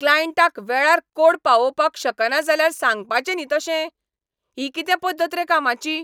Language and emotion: Goan Konkani, angry